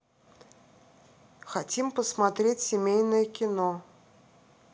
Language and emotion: Russian, neutral